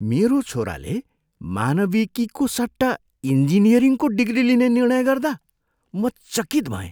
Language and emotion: Nepali, surprised